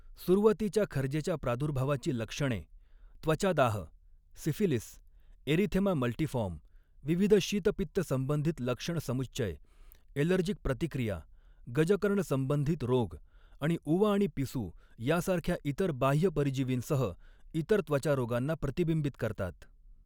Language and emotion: Marathi, neutral